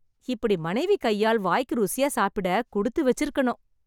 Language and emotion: Tamil, happy